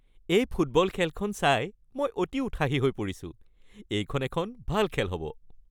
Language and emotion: Assamese, happy